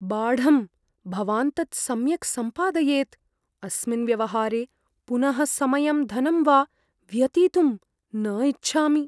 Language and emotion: Sanskrit, fearful